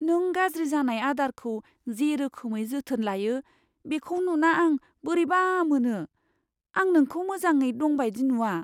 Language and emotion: Bodo, fearful